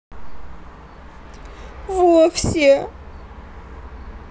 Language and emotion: Russian, sad